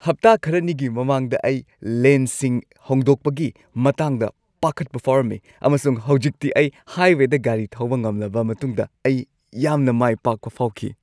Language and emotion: Manipuri, happy